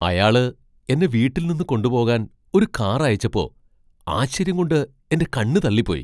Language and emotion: Malayalam, surprised